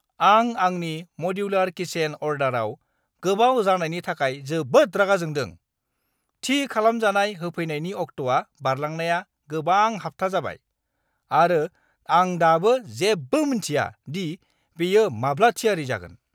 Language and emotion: Bodo, angry